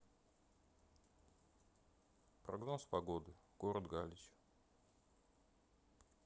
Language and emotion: Russian, neutral